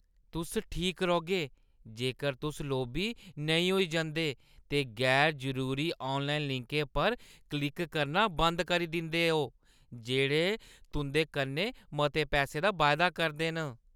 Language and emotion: Dogri, disgusted